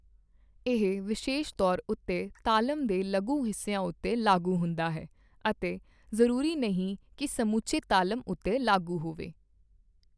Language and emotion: Punjabi, neutral